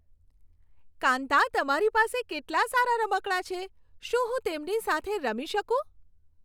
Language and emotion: Gujarati, happy